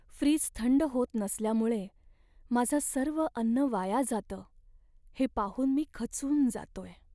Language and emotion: Marathi, sad